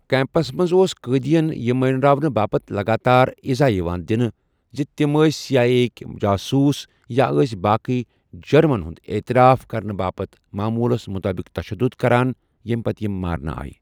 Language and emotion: Kashmiri, neutral